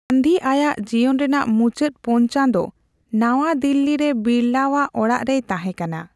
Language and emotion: Santali, neutral